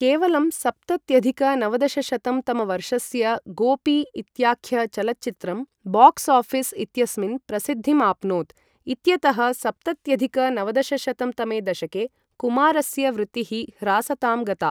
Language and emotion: Sanskrit, neutral